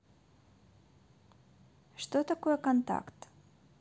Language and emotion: Russian, neutral